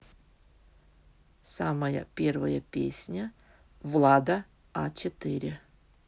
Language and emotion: Russian, neutral